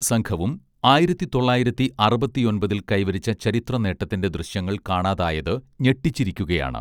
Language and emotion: Malayalam, neutral